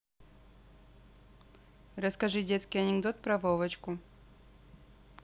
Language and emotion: Russian, neutral